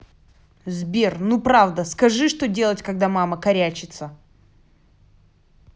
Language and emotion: Russian, angry